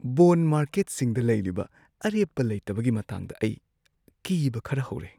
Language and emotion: Manipuri, fearful